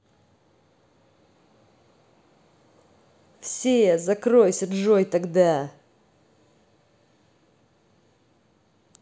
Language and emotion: Russian, angry